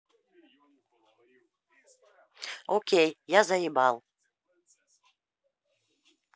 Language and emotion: Russian, angry